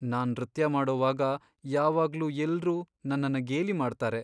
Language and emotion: Kannada, sad